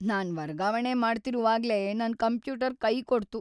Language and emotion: Kannada, sad